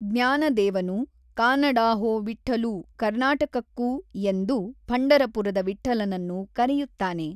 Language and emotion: Kannada, neutral